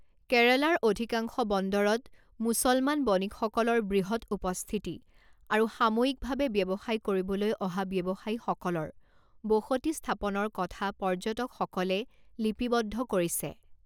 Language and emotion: Assamese, neutral